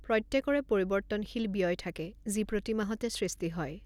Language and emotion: Assamese, neutral